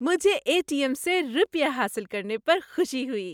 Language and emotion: Urdu, happy